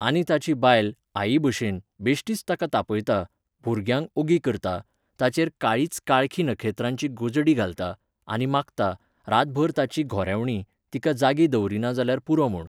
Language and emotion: Goan Konkani, neutral